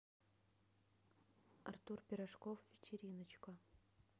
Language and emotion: Russian, neutral